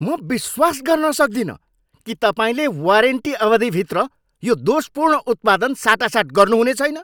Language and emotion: Nepali, angry